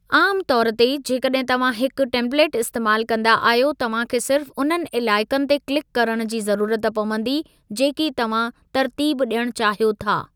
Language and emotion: Sindhi, neutral